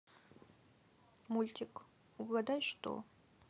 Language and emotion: Russian, sad